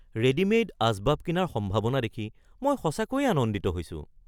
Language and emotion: Assamese, surprised